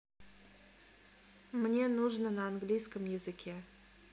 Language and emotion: Russian, neutral